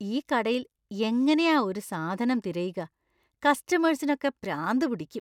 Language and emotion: Malayalam, disgusted